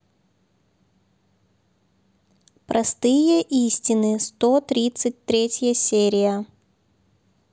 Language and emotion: Russian, neutral